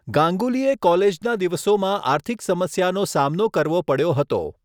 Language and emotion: Gujarati, neutral